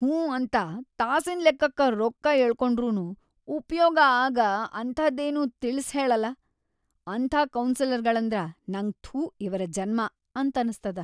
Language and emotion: Kannada, disgusted